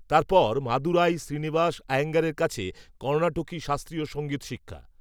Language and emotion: Bengali, neutral